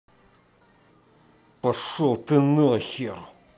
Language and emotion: Russian, angry